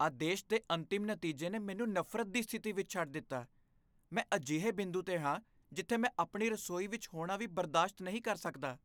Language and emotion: Punjabi, disgusted